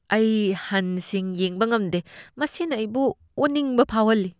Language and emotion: Manipuri, disgusted